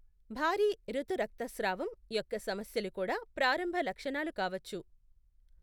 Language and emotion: Telugu, neutral